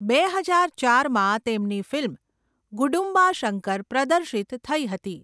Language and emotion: Gujarati, neutral